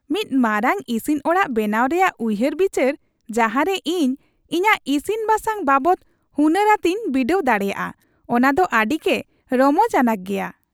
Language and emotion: Santali, happy